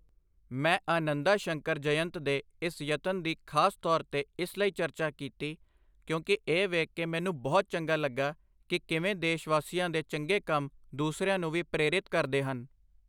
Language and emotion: Punjabi, neutral